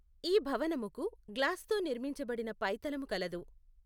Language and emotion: Telugu, neutral